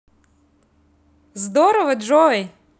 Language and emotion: Russian, positive